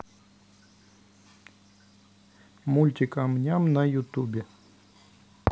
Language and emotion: Russian, neutral